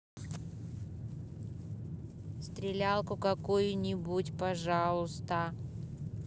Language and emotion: Russian, neutral